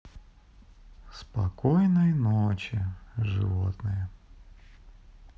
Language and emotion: Russian, neutral